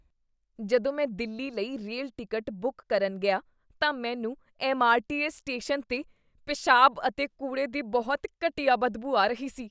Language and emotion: Punjabi, disgusted